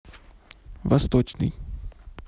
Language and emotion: Russian, neutral